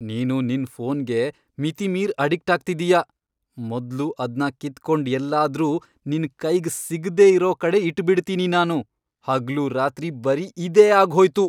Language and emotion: Kannada, angry